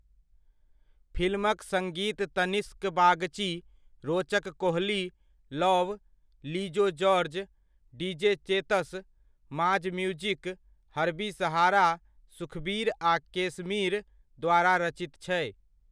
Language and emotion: Maithili, neutral